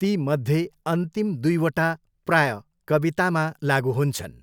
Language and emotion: Nepali, neutral